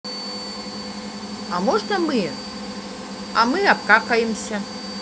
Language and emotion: Russian, positive